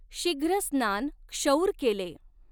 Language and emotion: Marathi, neutral